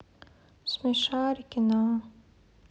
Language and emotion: Russian, sad